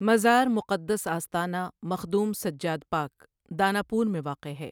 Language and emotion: Urdu, neutral